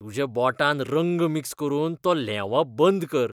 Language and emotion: Goan Konkani, disgusted